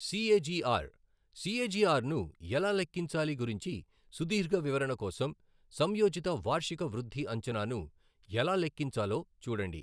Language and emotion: Telugu, neutral